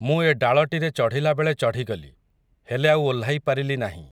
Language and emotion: Odia, neutral